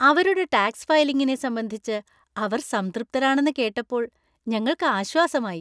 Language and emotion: Malayalam, happy